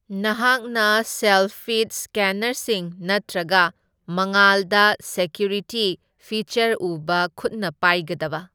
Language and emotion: Manipuri, neutral